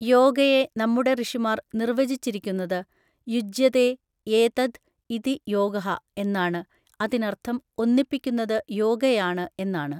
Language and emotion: Malayalam, neutral